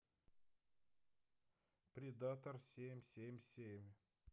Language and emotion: Russian, neutral